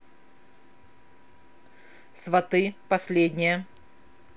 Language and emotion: Russian, neutral